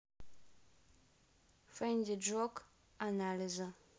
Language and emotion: Russian, neutral